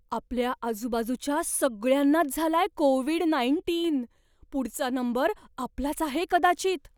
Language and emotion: Marathi, fearful